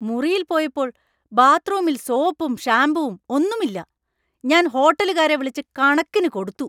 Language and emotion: Malayalam, angry